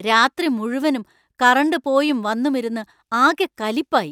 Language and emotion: Malayalam, angry